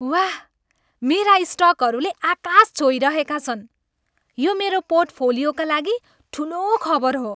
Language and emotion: Nepali, happy